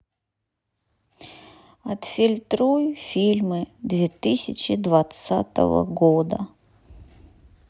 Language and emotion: Russian, sad